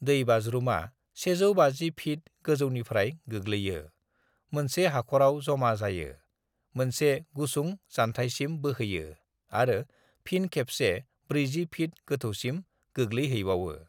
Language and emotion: Bodo, neutral